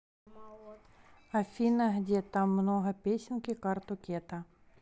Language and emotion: Russian, neutral